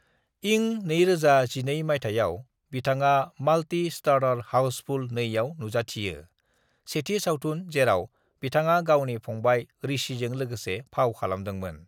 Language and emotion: Bodo, neutral